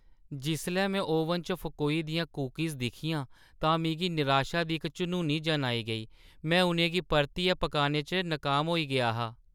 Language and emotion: Dogri, sad